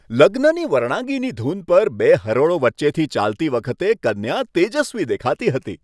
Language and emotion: Gujarati, happy